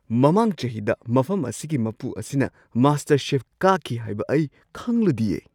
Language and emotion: Manipuri, surprised